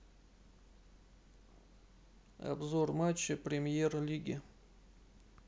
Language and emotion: Russian, neutral